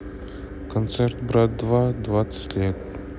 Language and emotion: Russian, neutral